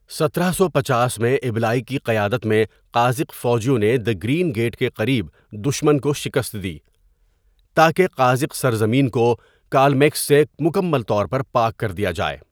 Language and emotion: Urdu, neutral